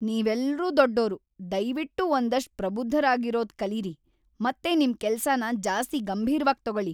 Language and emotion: Kannada, angry